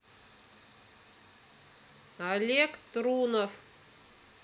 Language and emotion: Russian, neutral